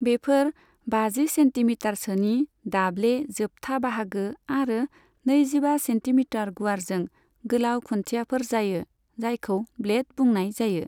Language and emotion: Bodo, neutral